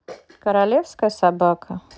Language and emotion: Russian, neutral